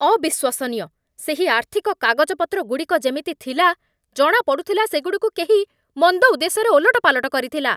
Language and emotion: Odia, angry